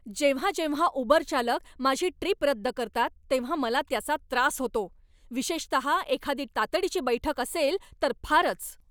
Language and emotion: Marathi, angry